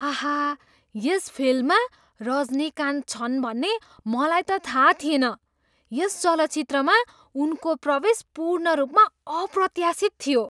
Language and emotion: Nepali, surprised